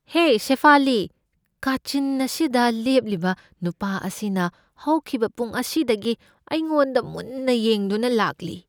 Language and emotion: Manipuri, fearful